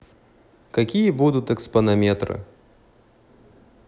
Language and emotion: Russian, neutral